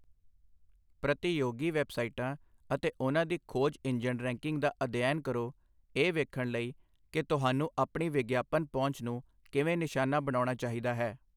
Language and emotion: Punjabi, neutral